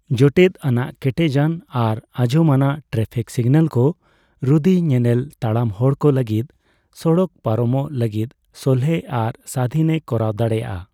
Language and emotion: Santali, neutral